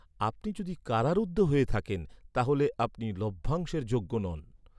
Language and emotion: Bengali, neutral